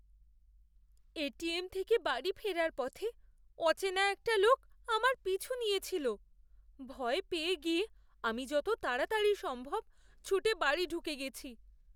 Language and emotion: Bengali, fearful